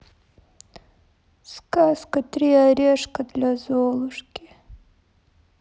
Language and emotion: Russian, sad